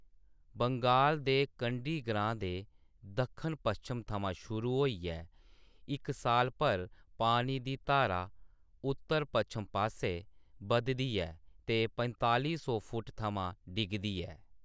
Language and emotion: Dogri, neutral